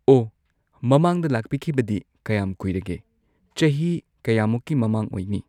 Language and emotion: Manipuri, neutral